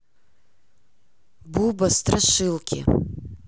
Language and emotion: Russian, neutral